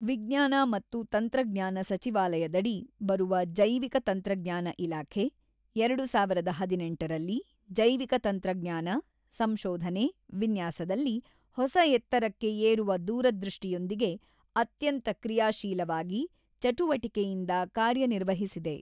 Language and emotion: Kannada, neutral